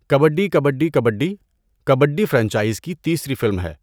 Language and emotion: Urdu, neutral